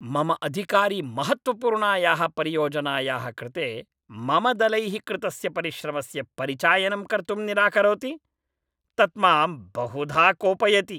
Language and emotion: Sanskrit, angry